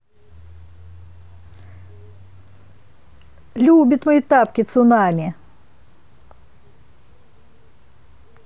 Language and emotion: Russian, neutral